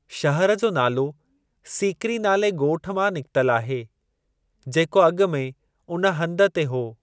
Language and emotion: Sindhi, neutral